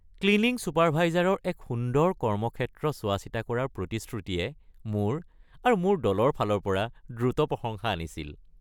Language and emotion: Assamese, happy